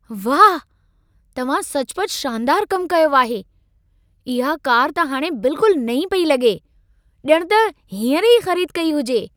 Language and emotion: Sindhi, surprised